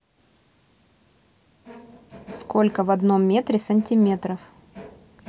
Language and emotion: Russian, neutral